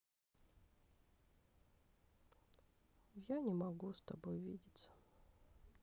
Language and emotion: Russian, sad